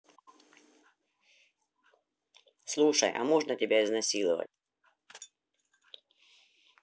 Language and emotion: Russian, neutral